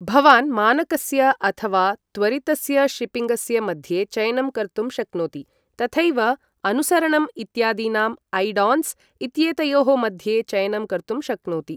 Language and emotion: Sanskrit, neutral